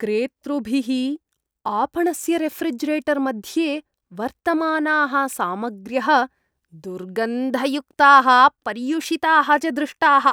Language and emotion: Sanskrit, disgusted